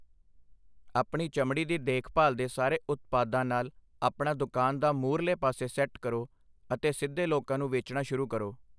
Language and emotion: Punjabi, neutral